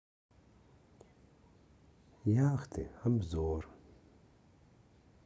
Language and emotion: Russian, sad